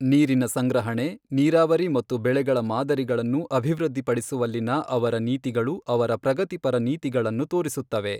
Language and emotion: Kannada, neutral